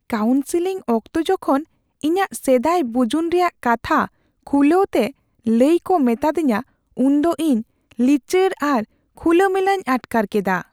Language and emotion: Santali, fearful